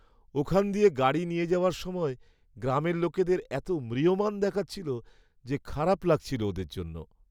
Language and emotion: Bengali, sad